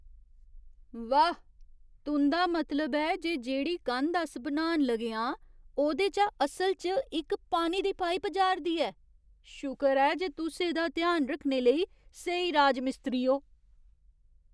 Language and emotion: Dogri, surprised